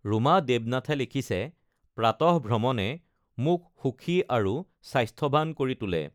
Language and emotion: Assamese, neutral